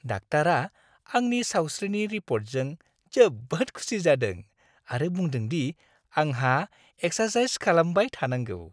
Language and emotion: Bodo, happy